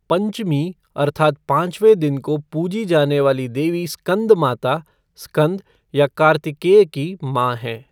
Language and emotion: Hindi, neutral